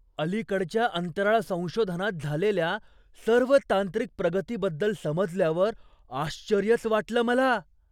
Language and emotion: Marathi, surprised